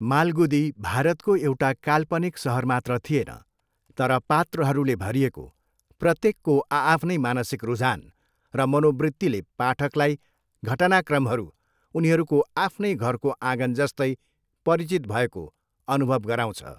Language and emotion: Nepali, neutral